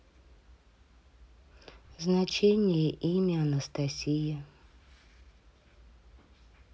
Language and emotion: Russian, neutral